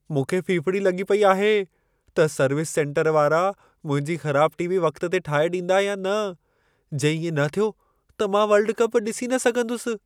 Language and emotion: Sindhi, fearful